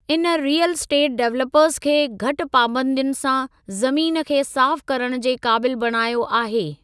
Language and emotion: Sindhi, neutral